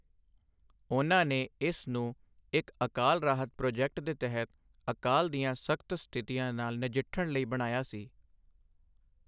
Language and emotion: Punjabi, neutral